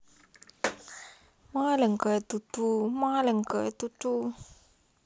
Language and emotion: Russian, sad